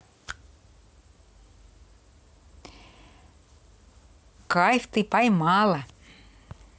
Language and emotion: Russian, positive